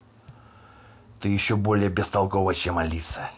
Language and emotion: Russian, angry